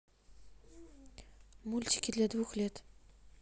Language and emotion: Russian, neutral